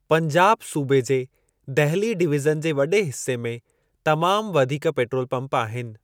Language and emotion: Sindhi, neutral